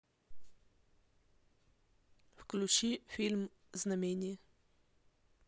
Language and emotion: Russian, neutral